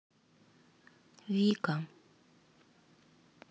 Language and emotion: Russian, sad